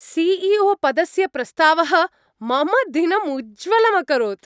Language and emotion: Sanskrit, happy